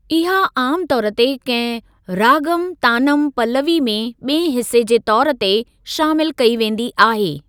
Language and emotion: Sindhi, neutral